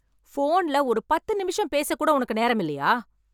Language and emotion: Tamil, angry